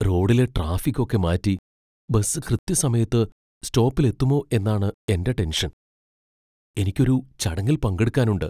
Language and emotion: Malayalam, fearful